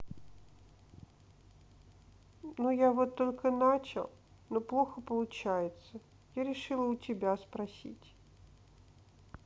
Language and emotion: Russian, sad